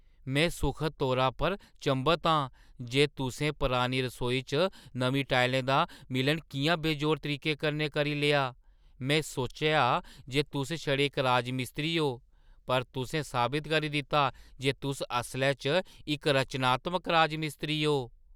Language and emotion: Dogri, surprised